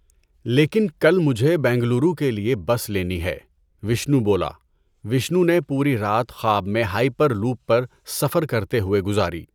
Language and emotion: Urdu, neutral